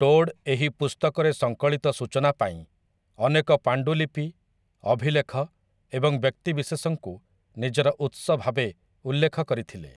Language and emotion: Odia, neutral